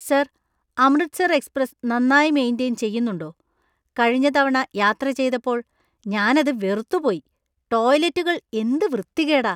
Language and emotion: Malayalam, disgusted